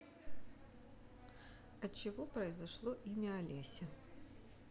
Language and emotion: Russian, neutral